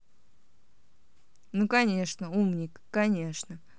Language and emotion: Russian, angry